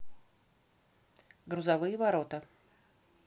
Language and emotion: Russian, neutral